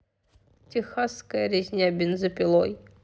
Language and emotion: Russian, neutral